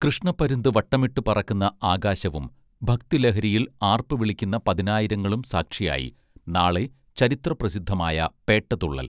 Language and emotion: Malayalam, neutral